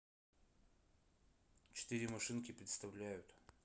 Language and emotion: Russian, neutral